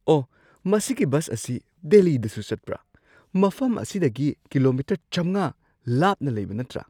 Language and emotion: Manipuri, surprised